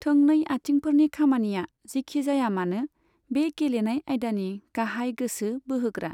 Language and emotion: Bodo, neutral